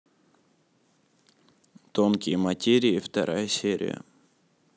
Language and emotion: Russian, neutral